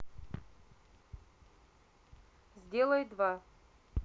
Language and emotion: Russian, neutral